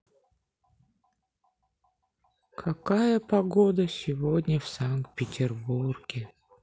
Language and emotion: Russian, sad